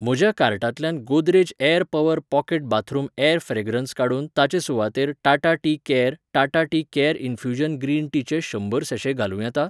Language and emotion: Goan Konkani, neutral